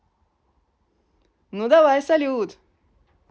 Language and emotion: Russian, positive